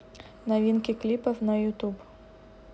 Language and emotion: Russian, neutral